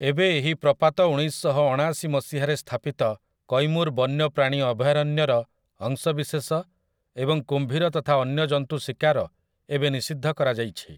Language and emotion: Odia, neutral